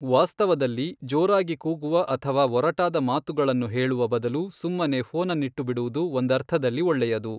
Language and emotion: Kannada, neutral